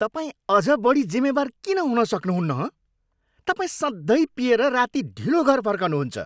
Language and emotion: Nepali, angry